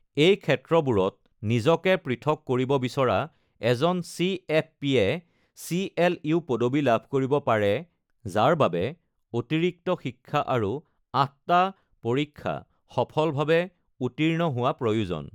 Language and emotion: Assamese, neutral